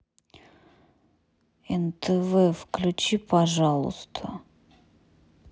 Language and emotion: Russian, neutral